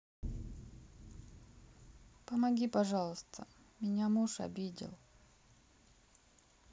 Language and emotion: Russian, sad